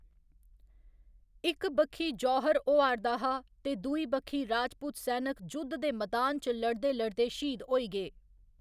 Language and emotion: Dogri, neutral